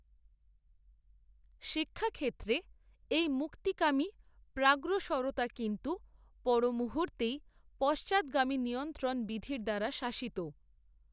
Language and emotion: Bengali, neutral